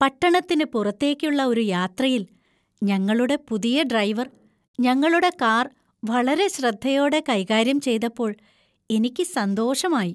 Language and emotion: Malayalam, happy